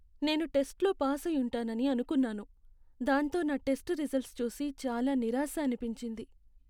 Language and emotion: Telugu, sad